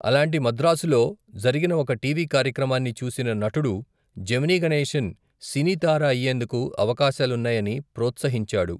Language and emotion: Telugu, neutral